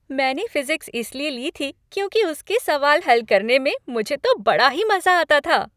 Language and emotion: Hindi, happy